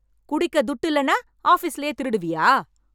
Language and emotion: Tamil, angry